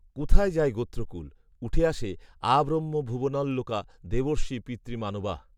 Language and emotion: Bengali, neutral